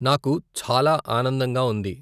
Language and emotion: Telugu, neutral